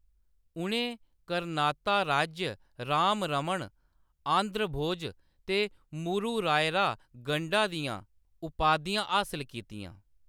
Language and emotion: Dogri, neutral